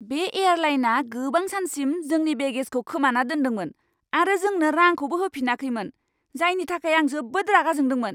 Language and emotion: Bodo, angry